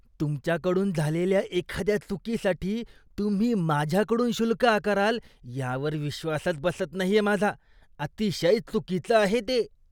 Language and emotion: Marathi, disgusted